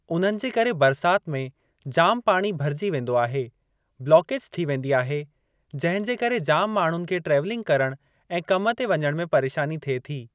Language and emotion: Sindhi, neutral